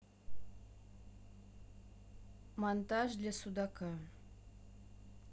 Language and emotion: Russian, neutral